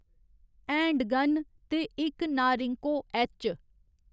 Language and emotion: Dogri, neutral